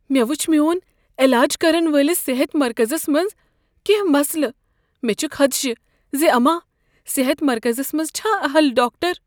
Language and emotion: Kashmiri, fearful